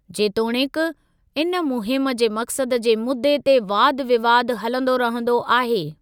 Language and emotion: Sindhi, neutral